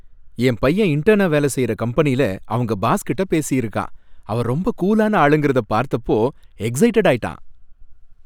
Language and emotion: Tamil, happy